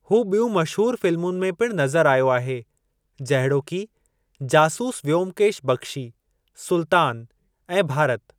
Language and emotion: Sindhi, neutral